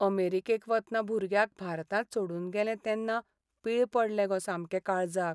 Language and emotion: Goan Konkani, sad